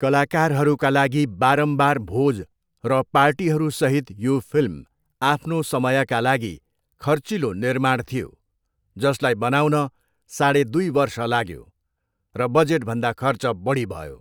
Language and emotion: Nepali, neutral